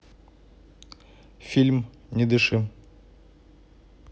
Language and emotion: Russian, neutral